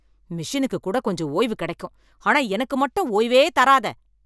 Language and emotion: Tamil, angry